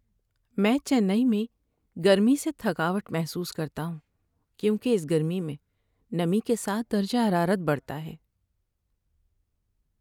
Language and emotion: Urdu, sad